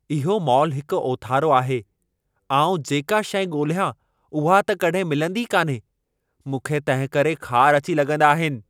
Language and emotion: Sindhi, angry